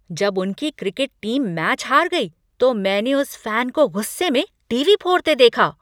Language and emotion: Hindi, angry